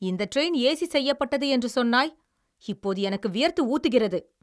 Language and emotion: Tamil, angry